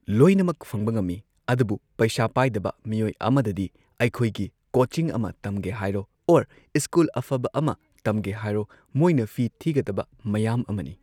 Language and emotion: Manipuri, neutral